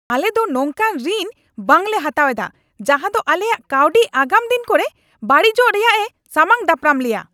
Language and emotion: Santali, angry